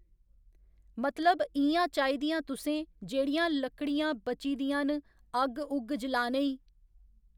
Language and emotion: Dogri, neutral